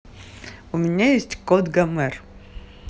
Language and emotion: Russian, positive